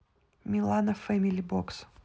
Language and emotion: Russian, neutral